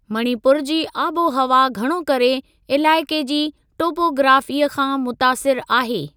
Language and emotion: Sindhi, neutral